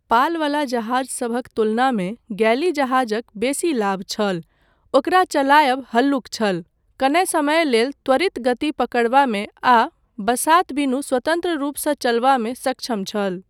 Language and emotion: Maithili, neutral